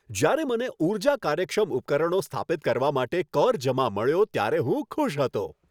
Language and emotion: Gujarati, happy